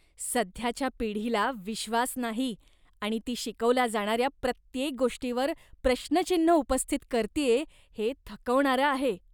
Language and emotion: Marathi, disgusted